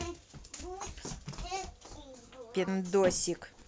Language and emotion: Russian, neutral